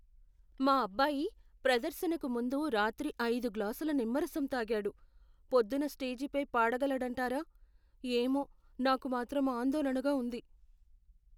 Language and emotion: Telugu, fearful